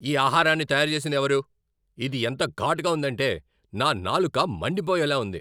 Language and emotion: Telugu, angry